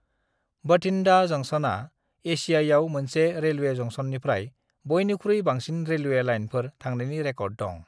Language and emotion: Bodo, neutral